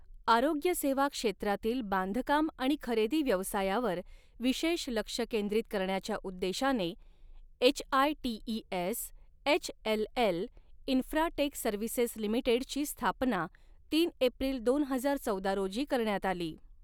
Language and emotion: Marathi, neutral